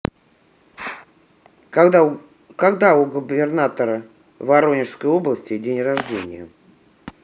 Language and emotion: Russian, neutral